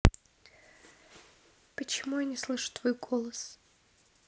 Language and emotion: Russian, neutral